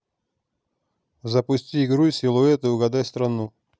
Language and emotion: Russian, neutral